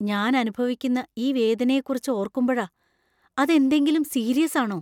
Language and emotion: Malayalam, fearful